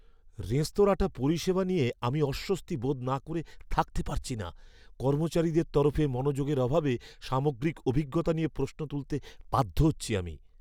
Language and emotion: Bengali, fearful